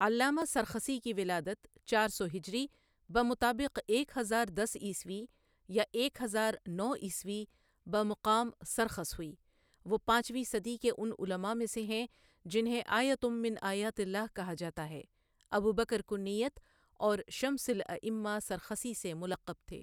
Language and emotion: Urdu, neutral